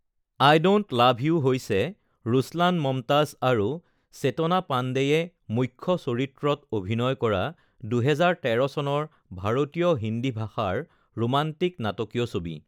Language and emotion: Assamese, neutral